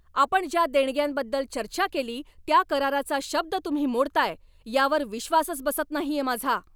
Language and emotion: Marathi, angry